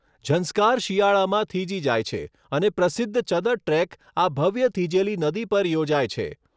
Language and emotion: Gujarati, neutral